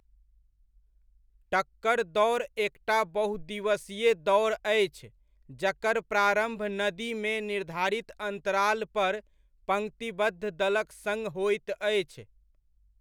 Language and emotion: Maithili, neutral